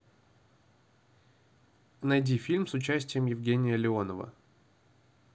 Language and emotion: Russian, neutral